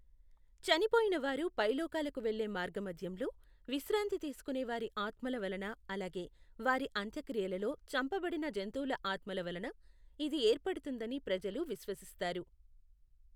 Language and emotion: Telugu, neutral